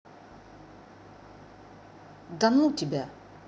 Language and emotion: Russian, angry